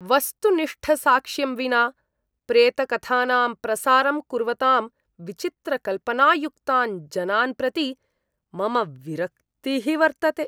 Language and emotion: Sanskrit, disgusted